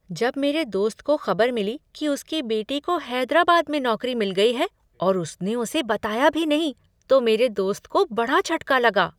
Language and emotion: Hindi, surprised